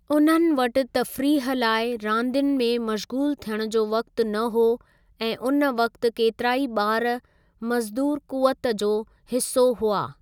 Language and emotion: Sindhi, neutral